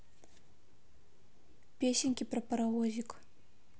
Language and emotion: Russian, neutral